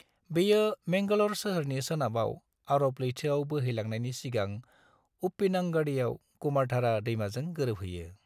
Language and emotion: Bodo, neutral